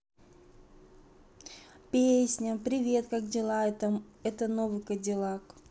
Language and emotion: Russian, positive